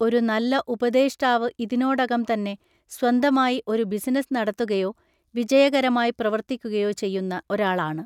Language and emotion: Malayalam, neutral